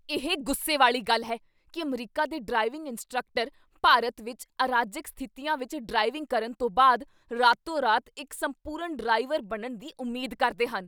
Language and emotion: Punjabi, angry